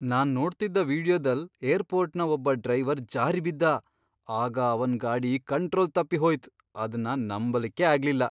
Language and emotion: Kannada, surprised